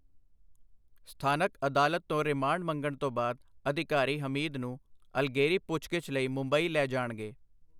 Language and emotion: Punjabi, neutral